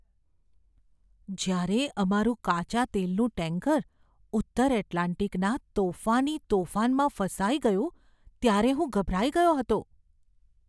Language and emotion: Gujarati, fearful